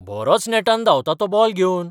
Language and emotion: Goan Konkani, surprised